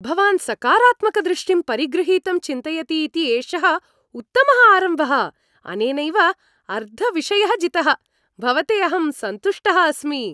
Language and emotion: Sanskrit, happy